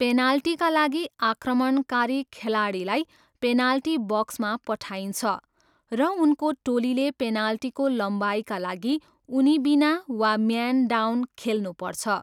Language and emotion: Nepali, neutral